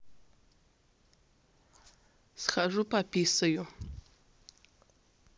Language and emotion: Russian, neutral